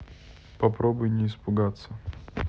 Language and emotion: Russian, neutral